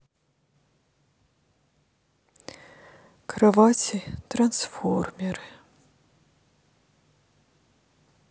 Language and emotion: Russian, sad